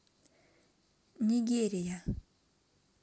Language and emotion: Russian, neutral